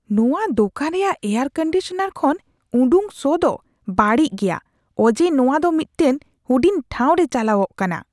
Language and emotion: Santali, disgusted